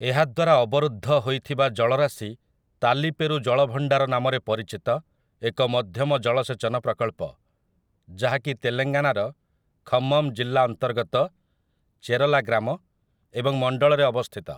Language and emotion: Odia, neutral